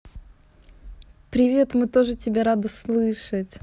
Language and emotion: Russian, positive